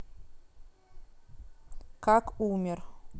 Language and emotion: Russian, neutral